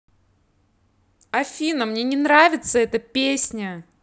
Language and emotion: Russian, angry